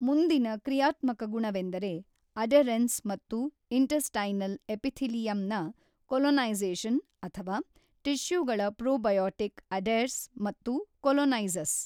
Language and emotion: Kannada, neutral